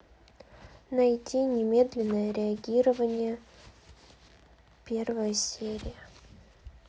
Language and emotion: Russian, neutral